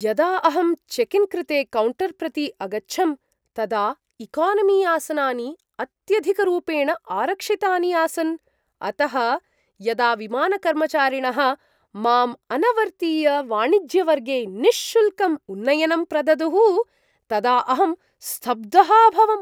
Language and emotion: Sanskrit, surprised